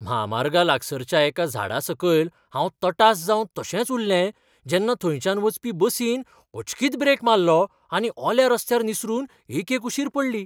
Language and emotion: Goan Konkani, surprised